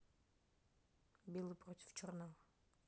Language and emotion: Russian, neutral